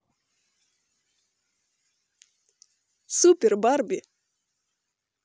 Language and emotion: Russian, positive